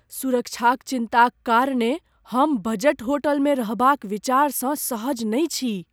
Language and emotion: Maithili, fearful